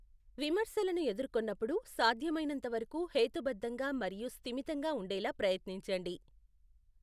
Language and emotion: Telugu, neutral